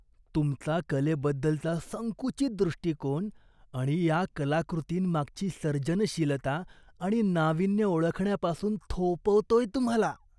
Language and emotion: Marathi, disgusted